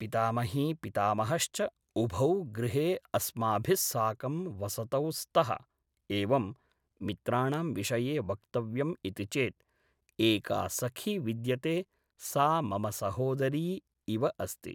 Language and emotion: Sanskrit, neutral